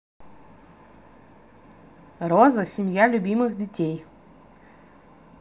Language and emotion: Russian, positive